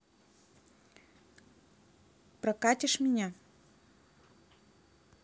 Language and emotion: Russian, neutral